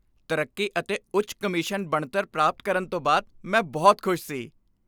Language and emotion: Punjabi, happy